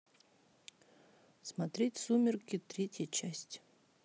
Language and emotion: Russian, neutral